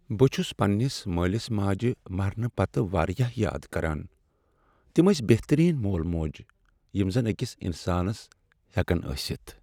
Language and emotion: Kashmiri, sad